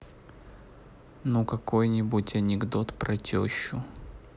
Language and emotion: Russian, neutral